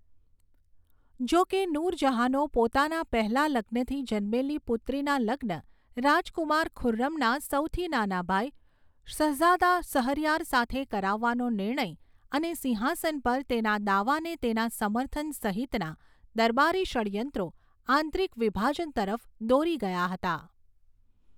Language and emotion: Gujarati, neutral